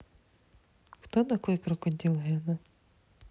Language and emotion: Russian, neutral